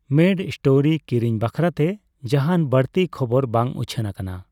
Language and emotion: Santali, neutral